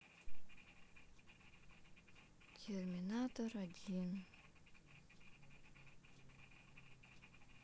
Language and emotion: Russian, sad